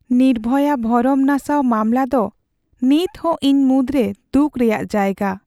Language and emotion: Santali, sad